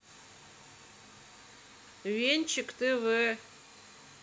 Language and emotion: Russian, neutral